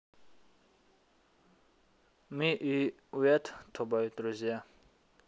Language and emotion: Russian, neutral